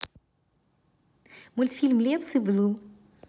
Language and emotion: Russian, neutral